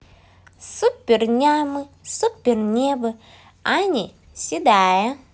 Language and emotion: Russian, positive